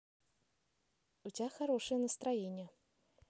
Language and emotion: Russian, positive